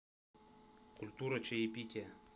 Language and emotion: Russian, neutral